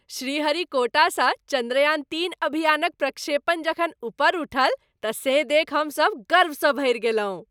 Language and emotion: Maithili, happy